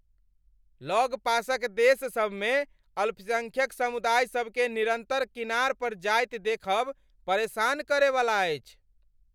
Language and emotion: Maithili, angry